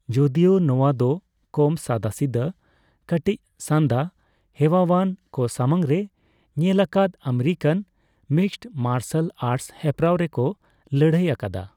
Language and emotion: Santali, neutral